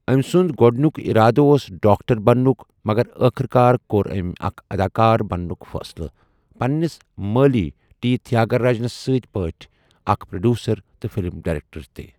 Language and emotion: Kashmiri, neutral